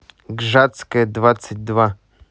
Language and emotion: Russian, neutral